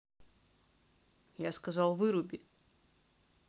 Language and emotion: Russian, angry